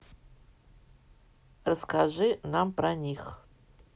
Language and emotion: Russian, neutral